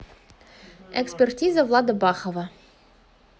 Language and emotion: Russian, neutral